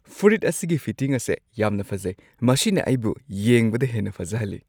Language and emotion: Manipuri, happy